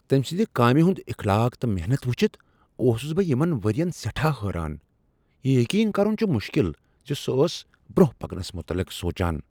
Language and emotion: Kashmiri, surprised